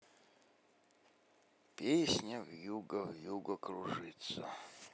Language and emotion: Russian, sad